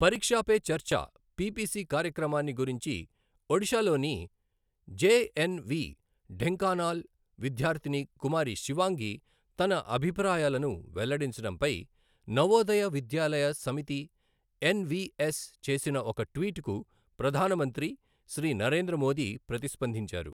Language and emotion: Telugu, neutral